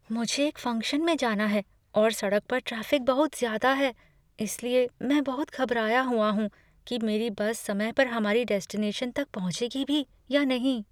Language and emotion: Hindi, fearful